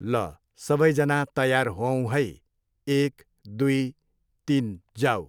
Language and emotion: Nepali, neutral